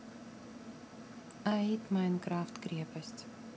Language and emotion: Russian, neutral